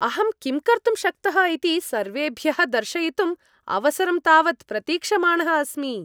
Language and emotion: Sanskrit, happy